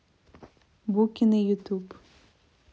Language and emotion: Russian, neutral